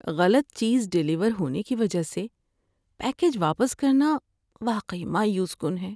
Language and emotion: Urdu, sad